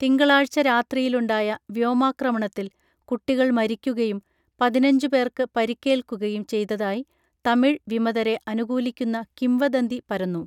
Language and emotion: Malayalam, neutral